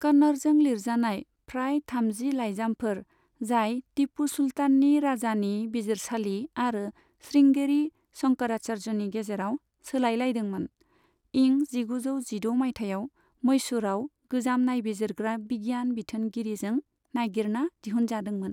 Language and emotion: Bodo, neutral